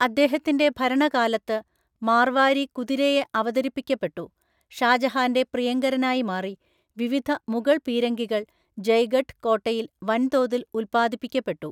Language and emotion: Malayalam, neutral